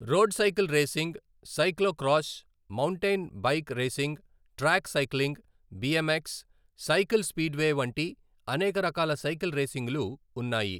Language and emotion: Telugu, neutral